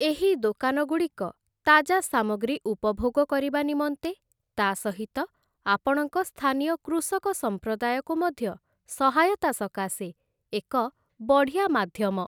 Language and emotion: Odia, neutral